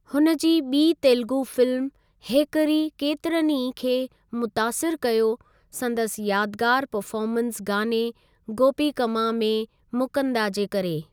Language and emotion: Sindhi, neutral